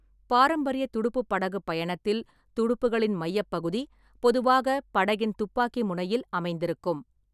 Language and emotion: Tamil, neutral